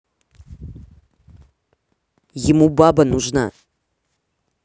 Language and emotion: Russian, angry